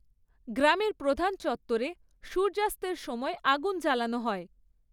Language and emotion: Bengali, neutral